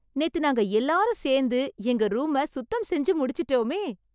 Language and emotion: Tamil, happy